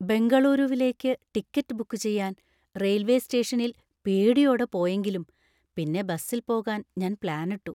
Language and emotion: Malayalam, fearful